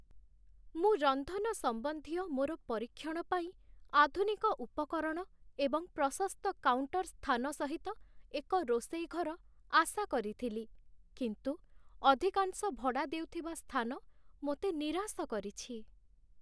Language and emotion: Odia, sad